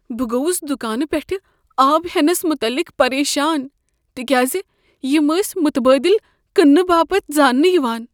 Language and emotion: Kashmiri, fearful